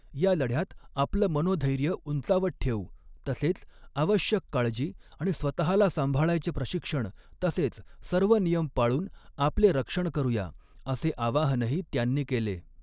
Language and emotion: Marathi, neutral